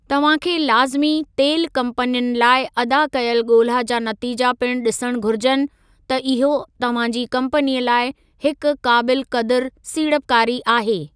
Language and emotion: Sindhi, neutral